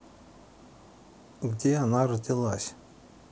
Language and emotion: Russian, neutral